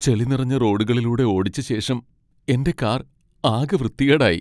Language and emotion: Malayalam, sad